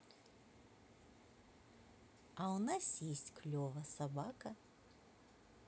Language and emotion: Russian, positive